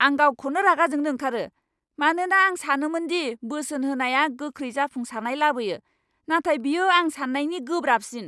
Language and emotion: Bodo, angry